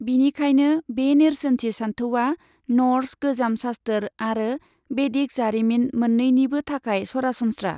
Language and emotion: Bodo, neutral